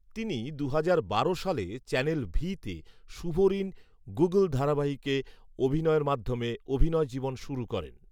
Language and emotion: Bengali, neutral